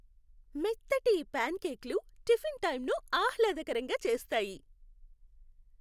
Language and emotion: Telugu, happy